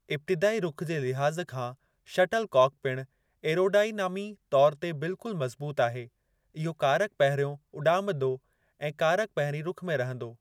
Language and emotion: Sindhi, neutral